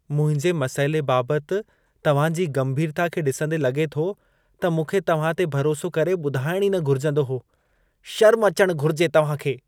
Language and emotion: Sindhi, disgusted